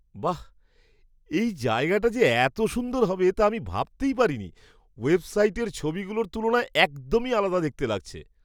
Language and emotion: Bengali, surprised